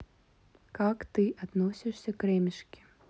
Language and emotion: Russian, neutral